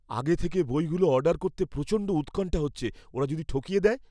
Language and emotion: Bengali, fearful